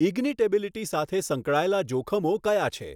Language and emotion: Gujarati, neutral